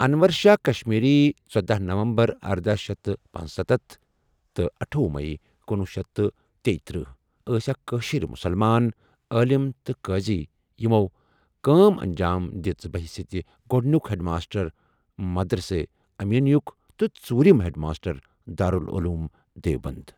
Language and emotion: Kashmiri, neutral